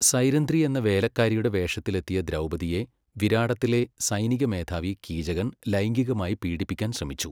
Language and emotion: Malayalam, neutral